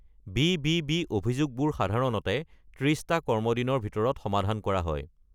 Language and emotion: Assamese, neutral